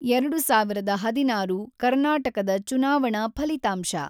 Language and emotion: Kannada, neutral